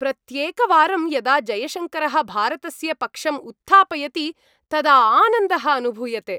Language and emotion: Sanskrit, happy